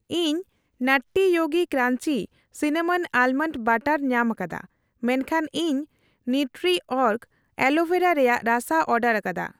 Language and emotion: Santali, neutral